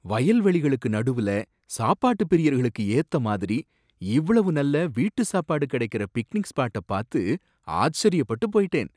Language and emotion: Tamil, surprised